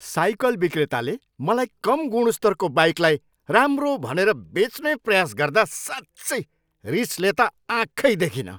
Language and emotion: Nepali, angry